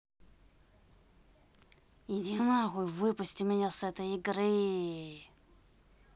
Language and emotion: Russian, angry